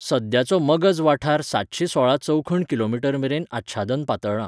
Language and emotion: Goan Konkani, neutral